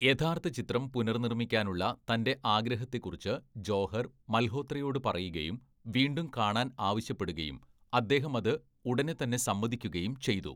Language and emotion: Malayalam, neutral